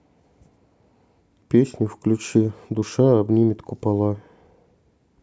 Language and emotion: Russian, neutral